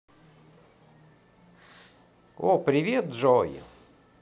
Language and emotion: Russian, positive